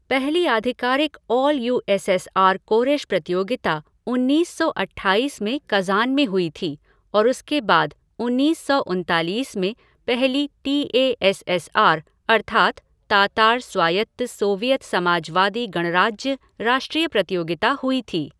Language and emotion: Hindi, neutral